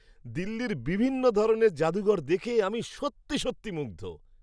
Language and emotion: Bengali, surprised